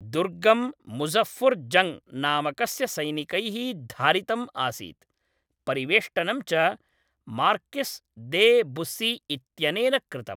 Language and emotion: Sanskrit, neutral